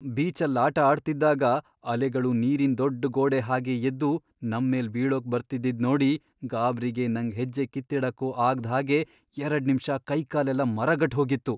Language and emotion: Kannada, fearful